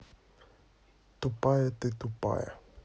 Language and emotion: Russian, neutral